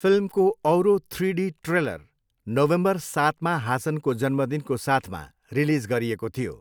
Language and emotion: Nepali, neutral